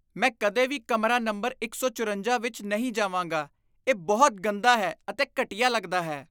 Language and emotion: Punjabi, disgusted